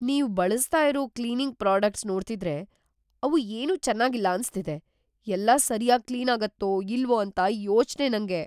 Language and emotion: Kannada, fearful